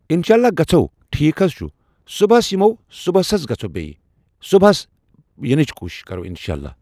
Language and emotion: Kashmiri, neutral